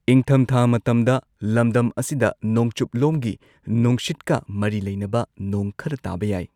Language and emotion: Manipuri, neutral